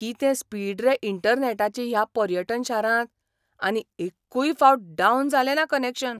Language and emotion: Goan Konkani, surprised